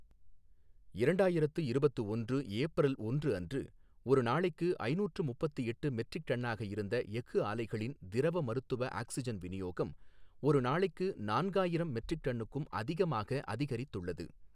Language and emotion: Tamil, neutral